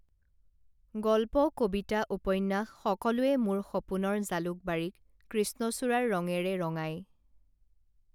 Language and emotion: Assamese, neutral